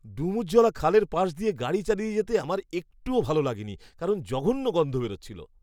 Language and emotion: Bengali, disgusted